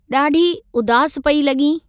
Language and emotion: Sindhi, neutral